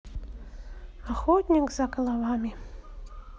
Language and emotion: Russian, neutral